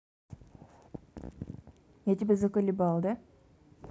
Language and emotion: Russian, neutral